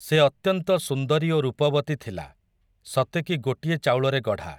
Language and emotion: Odia, neutral